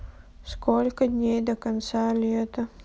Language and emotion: Russian, sad